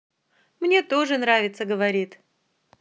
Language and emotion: Russian, positive